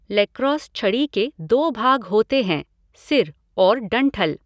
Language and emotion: Hindi, neutral